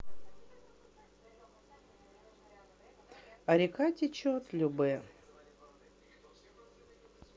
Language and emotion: Russian, neutral